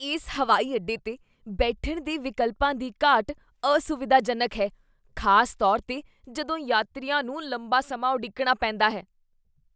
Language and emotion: Punjabi, disgusted